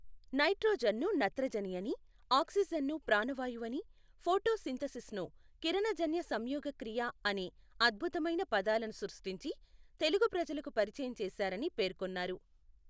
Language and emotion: Telugu, neutral